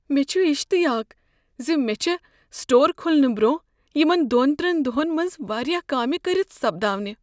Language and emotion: Kashmiri, fearful